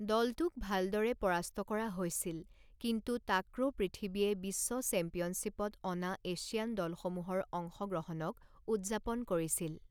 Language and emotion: Assamese, neutral